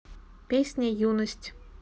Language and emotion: Russian, neutral